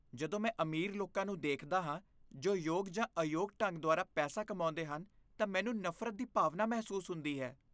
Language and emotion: Punjabi, disgusted